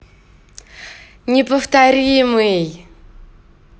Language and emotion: Russian, positive